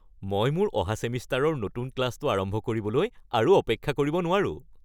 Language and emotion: Assamese, happy